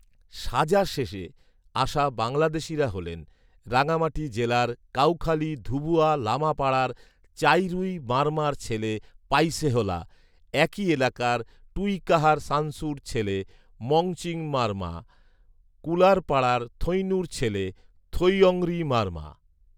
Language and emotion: Bengali, neutral